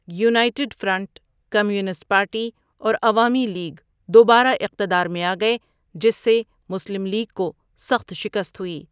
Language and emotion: Urdu, neutral